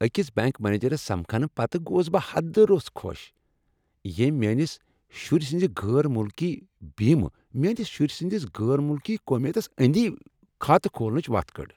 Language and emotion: Kashmiri, happy